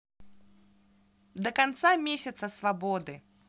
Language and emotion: Russian, positive